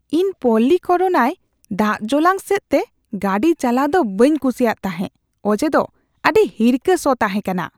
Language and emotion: Santali, disgusted